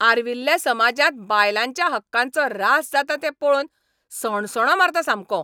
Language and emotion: Goan Konkani, angry